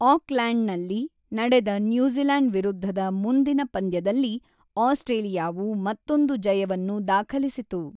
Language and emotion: Kannada, neutral